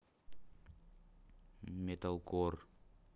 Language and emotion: Russian, neutral